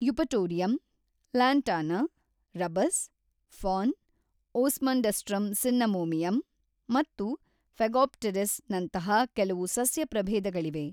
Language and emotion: Kannada, neutral